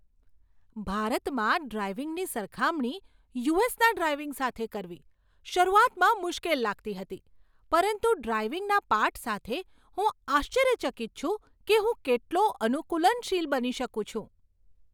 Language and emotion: Gujarati, surprised